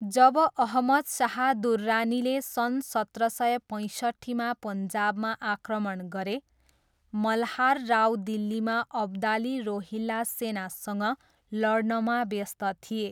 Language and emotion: Nepali, neutral